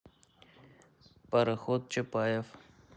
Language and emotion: Russian, neutral